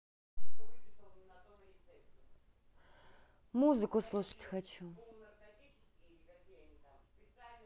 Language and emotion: Russian, neutral